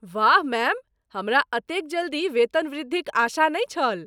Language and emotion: Maithili, surprised